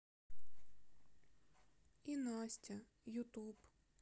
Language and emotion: Russian, sad